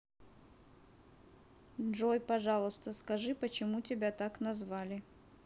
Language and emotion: Russian, neutral